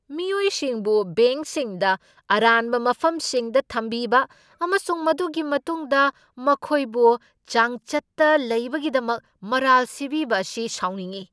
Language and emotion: Manipuri, angry